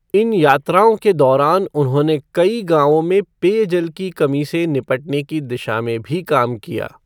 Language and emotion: Hindi, neutral